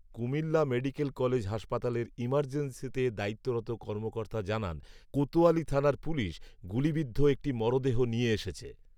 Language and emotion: Bengali, neutral